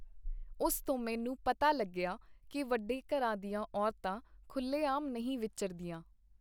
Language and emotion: Punjabi, neutral